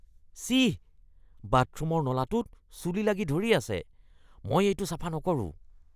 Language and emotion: Assamese, disgusted